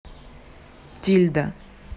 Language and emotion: Russian, neutral